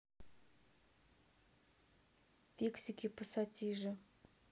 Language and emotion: Russian, neutral